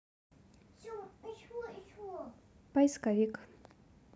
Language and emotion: Russian, neutral